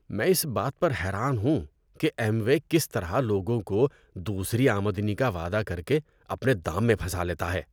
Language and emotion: Urdu, disgusted